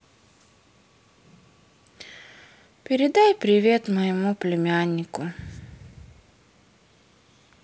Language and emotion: Russian, sad